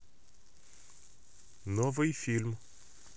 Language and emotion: Russian, neutral